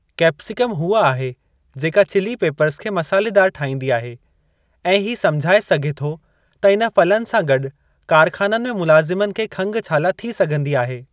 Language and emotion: Sindhi, neutral